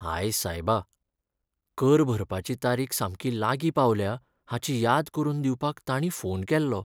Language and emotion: Goan Konkani, sad